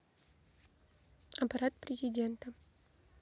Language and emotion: Russian, neutral